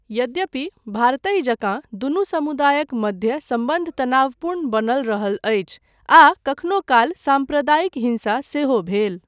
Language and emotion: Maithili, neutral